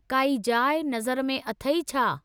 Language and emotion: Sindhi, neutral